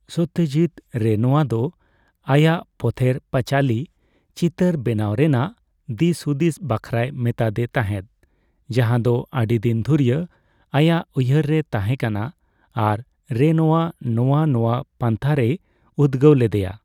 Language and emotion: Santali, neutral